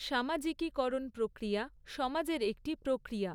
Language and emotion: Bengali, neutral